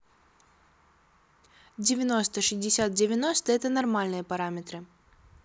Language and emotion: Russian, neutral